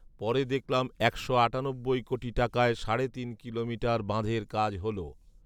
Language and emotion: Bengali, neutral